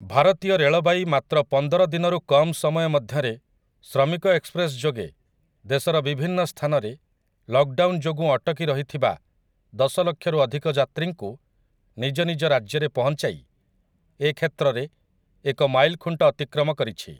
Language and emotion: Odia, neutral